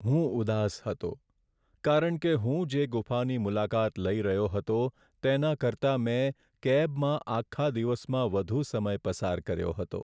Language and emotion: Gujarati, sad